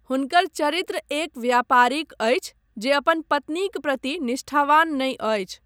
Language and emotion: Maithili, neutral